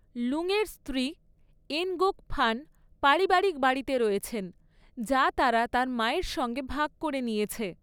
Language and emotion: Bengali, neutral